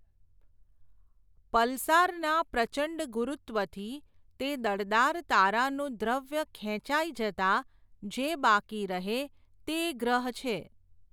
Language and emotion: Gujarati, neutral